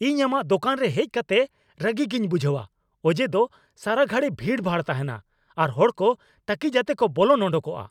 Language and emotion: Santali, angry